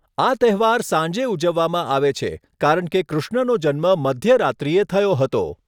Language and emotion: Gujarati, neutral